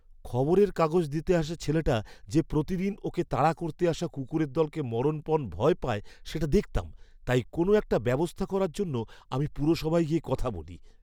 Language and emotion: Bengali, fearful